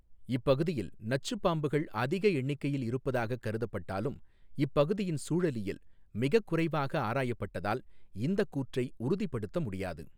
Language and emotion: Tamil, neutral